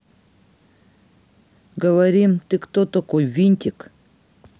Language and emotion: Russian, neutral